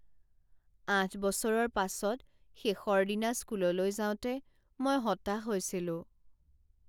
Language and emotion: Assamese, sad